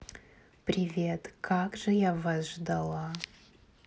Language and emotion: Russian, neutral